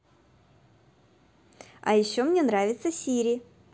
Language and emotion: Russian, positive